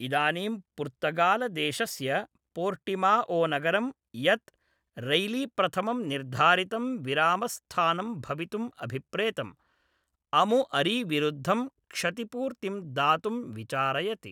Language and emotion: Sanskrit, neutral